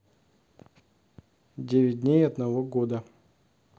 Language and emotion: Russian, neutral